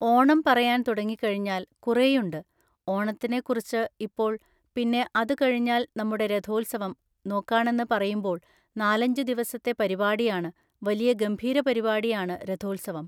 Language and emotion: Malayalam, neutral